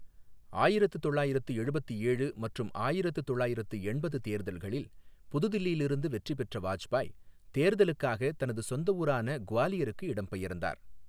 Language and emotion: Tamil, neutral